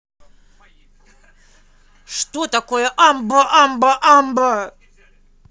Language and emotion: Russian, angry